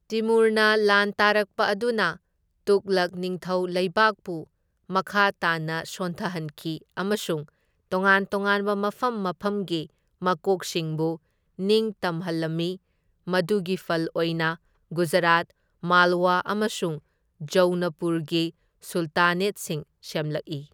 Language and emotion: Manipuri, neutral